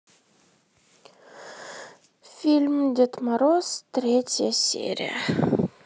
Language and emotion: Russian, sad